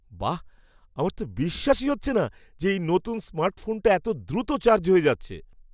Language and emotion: Bengali, surprised